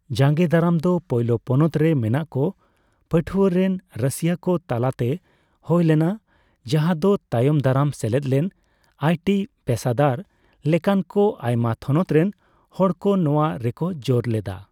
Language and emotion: Santali, neutral